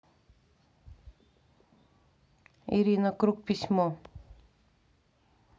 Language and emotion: Russian, neutral